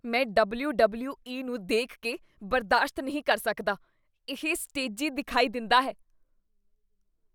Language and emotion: Punjabi, disgusted